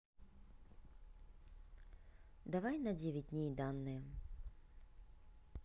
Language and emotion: Russian, neutral